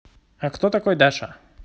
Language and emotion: Russian, neutral